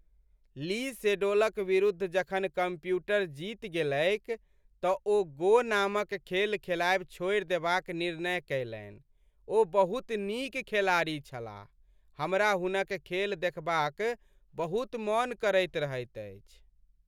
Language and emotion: Maithili, sad